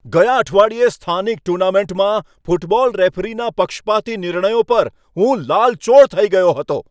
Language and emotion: Gujarati, angry